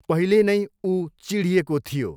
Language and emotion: Nepali, neutral